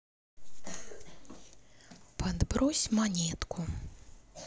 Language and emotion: Russian, neutral